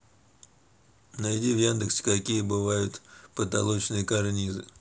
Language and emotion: Russian, neutral